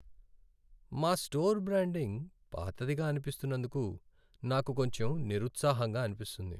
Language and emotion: Telugu, sad